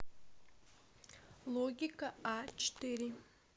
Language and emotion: Russian, neutral